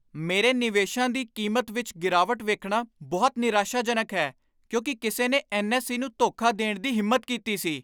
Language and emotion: Punjabi, angry